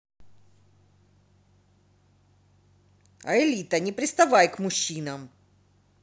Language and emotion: Russian, angry